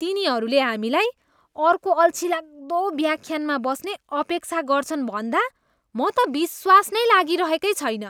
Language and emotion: Nepali, disgusted